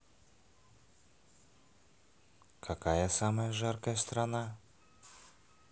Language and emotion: Russian, positive